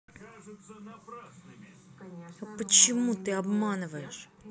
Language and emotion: Russian, angry